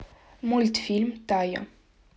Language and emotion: Russian, neutral